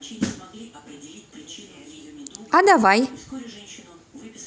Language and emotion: Russian, positive